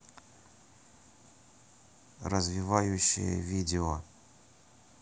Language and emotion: Russian, neutral